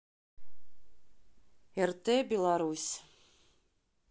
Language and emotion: Russian, neutral